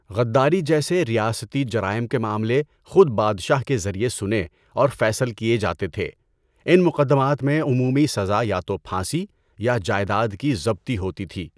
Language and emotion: Urdu, neutral